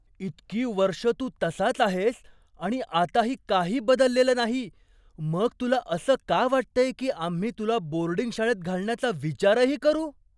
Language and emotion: Marathi, surprised